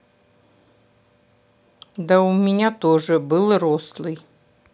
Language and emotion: Russian, sad